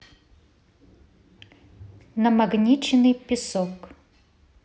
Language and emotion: Russian, neutral